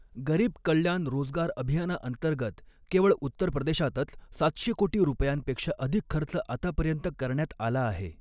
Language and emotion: Marathi, neutral